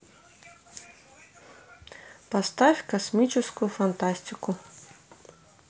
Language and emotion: Russian, neutral